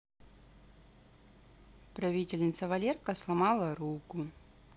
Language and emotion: Russian, neutral